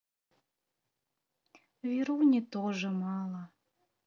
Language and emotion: Russian, sad